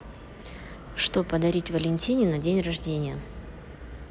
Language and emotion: Russian, neutral